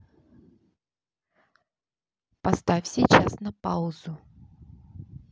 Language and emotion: Russian, neutral